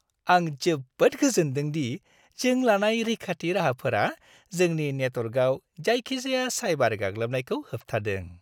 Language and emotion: Bodo, happy